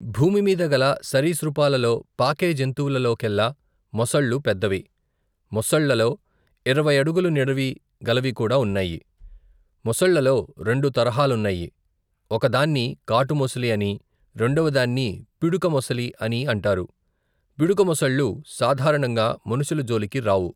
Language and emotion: Telugu, neutral